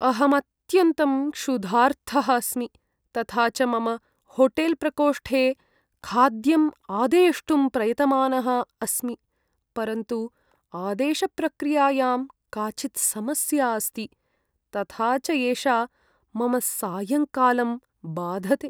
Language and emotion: Sanskrit, sad